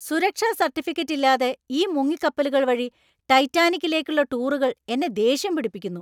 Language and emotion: Malayalam, angry